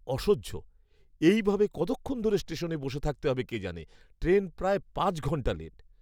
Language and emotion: Bengali, disgusted